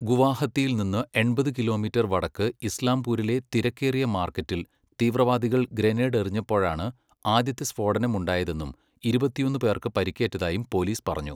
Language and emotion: Malayalam, neutral